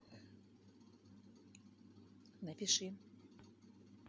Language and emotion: Russian, neutral